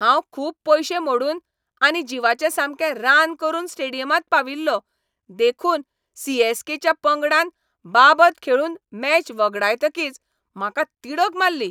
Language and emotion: Goan Konkani, angry